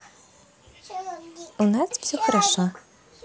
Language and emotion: Russian, positive